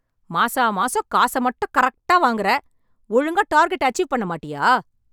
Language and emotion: Tamil, angry